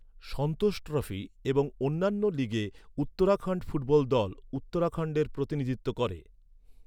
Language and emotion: Bengali, neutral